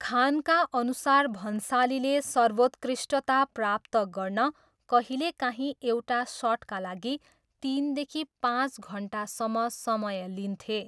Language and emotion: Nepali, neutral